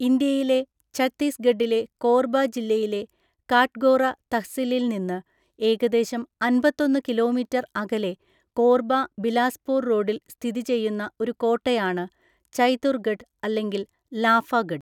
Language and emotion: Malayalam, neutral